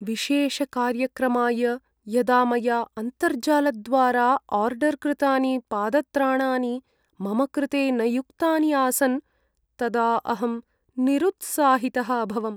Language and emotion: Sanskrit, sad